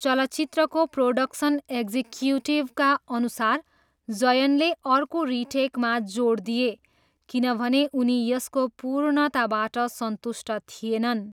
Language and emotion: Nepali, neutral